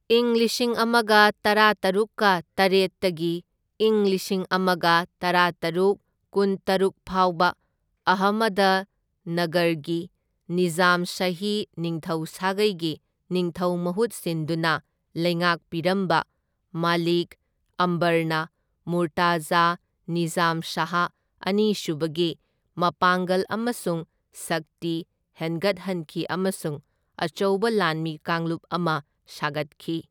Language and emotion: Manipuri, neutral